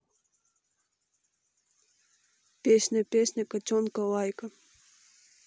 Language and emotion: Russian, neutral